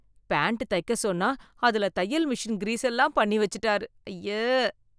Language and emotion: Tamil, disgusted